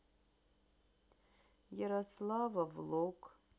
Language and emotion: Russian, sad